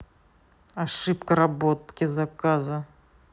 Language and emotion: Russian, neutral